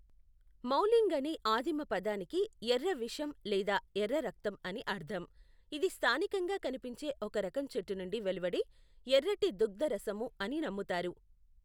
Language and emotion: Telugu, neutral